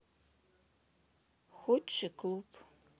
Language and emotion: Russian, sad